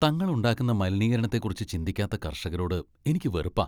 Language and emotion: Malayalam, disgusted